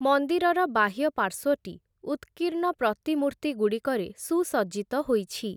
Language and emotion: Odia, neutral